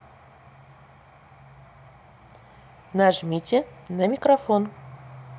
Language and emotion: Russian, neutral